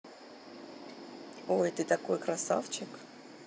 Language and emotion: Russian, positive